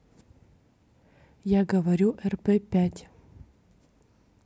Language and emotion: Russian, neutral